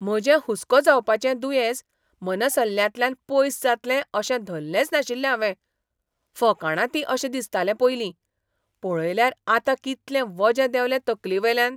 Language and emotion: Goan Konkani, surprised